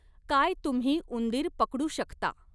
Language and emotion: Marathi, neutral